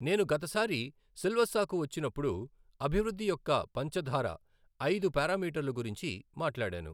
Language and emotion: Telugu, neutral